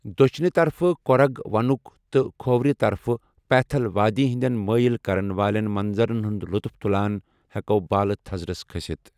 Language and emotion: Kashmiri, neutral